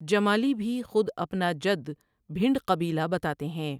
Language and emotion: Urdu, neutral